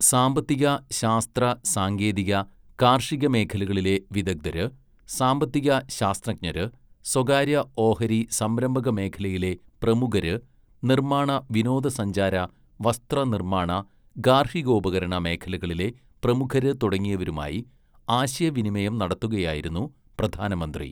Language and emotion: Malayalam, neutral